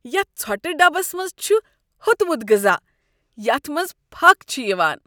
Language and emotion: Kashmiri, disgusted